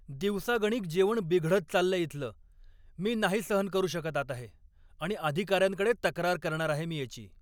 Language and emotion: Marathi, angry